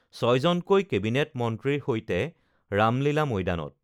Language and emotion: Assamese, neutral